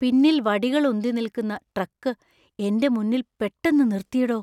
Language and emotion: Malayalam, fearful